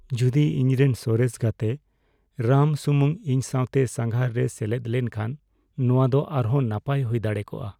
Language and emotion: Santali, sad